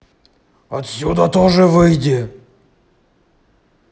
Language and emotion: Russian, angry